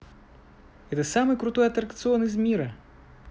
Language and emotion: Russian, positive